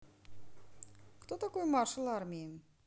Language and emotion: Russian, neutral